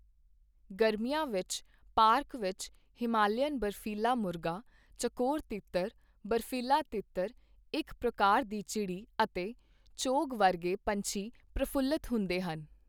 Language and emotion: Punjabi, neutral